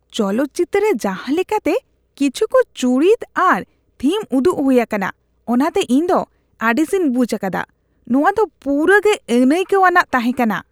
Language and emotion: Santali, disgusted